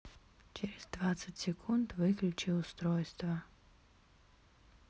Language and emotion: Russian, neutral